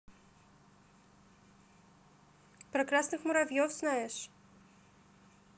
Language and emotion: Russian, positive